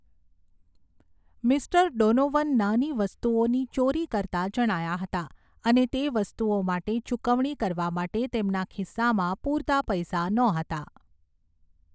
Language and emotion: Gujarati, neutral